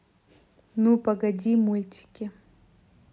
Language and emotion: Russian, neutral